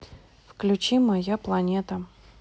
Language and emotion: Russian, neutral